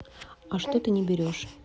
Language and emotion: Russian, neutral